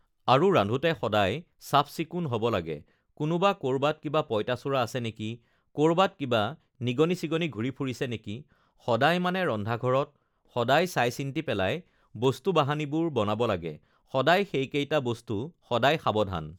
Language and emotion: Assamese, neutral